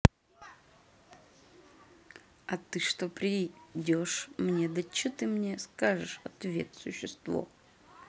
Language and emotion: Russian, angry